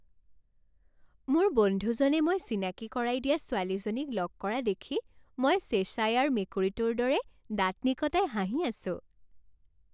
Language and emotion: Assamese, happy